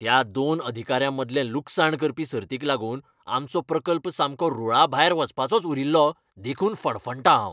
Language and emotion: Goan Konkani, angry